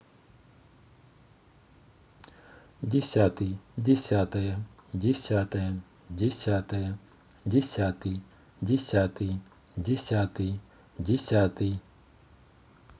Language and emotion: Russian, neutral